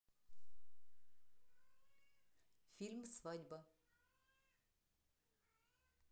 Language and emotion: Russian, neutral